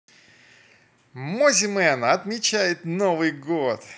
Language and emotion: Russian, positive